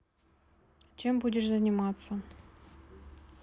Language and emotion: Russian, neutral